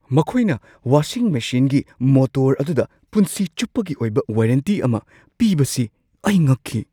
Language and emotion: Manipuri, surprised